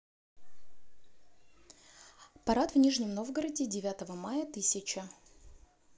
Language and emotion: Russian, neutral